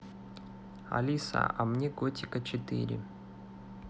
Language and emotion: Russian, neutral